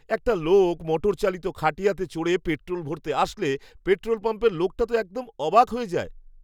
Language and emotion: Bengali, surprised